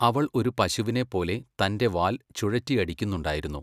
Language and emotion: Malayalam, neutral